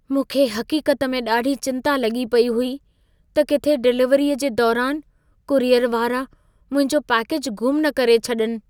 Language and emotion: Sindhi, fearful